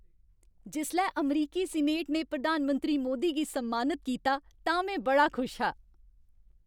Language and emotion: Dogri, happy